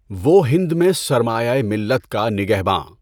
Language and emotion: Urdu, neutral